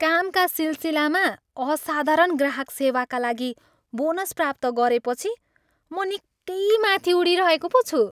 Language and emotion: Nepali, happy